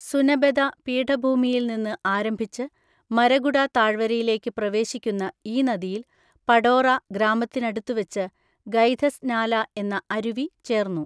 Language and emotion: Malayalam, neutral